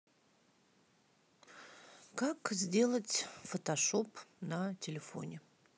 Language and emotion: Russian, sad